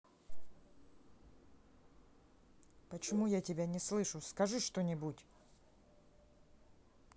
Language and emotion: Russian, angry